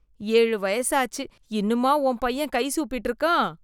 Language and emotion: Tamil, disgusted